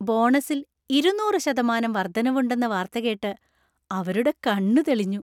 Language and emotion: Malayalam, happy